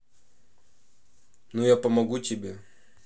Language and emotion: Russian, neutral